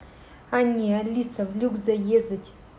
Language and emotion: Russian, neutral